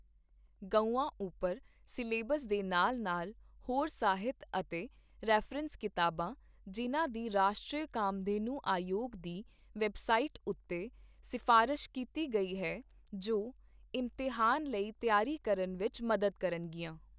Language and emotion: Punjabi, neutral